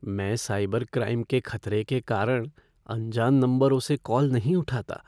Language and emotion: Hindi, fearful